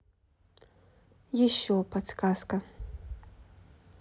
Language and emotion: Russian, neutral